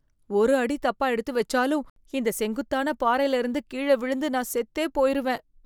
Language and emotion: Tamil, fearful